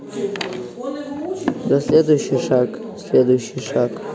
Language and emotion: Russian, neutral